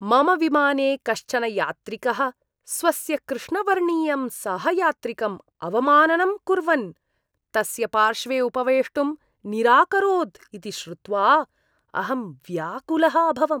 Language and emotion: Sanskrit, disgusted